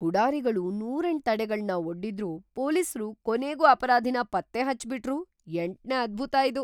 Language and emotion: Kannada, surprised